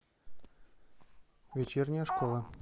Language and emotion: Russian, neutral